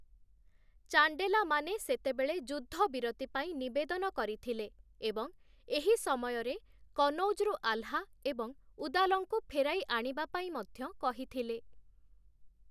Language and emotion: Odia, neutral